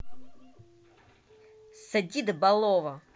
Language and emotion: Russian, angry